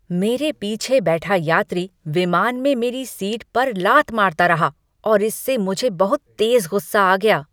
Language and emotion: Hindi, angry